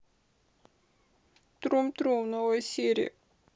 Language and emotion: Russian, sad